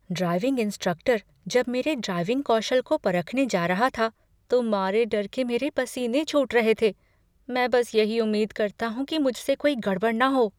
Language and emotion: Hindi, fearful